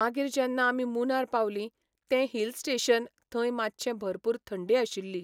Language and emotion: Goan Konkani, neutral